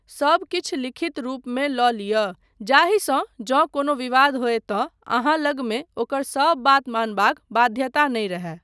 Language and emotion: Maithili, neutral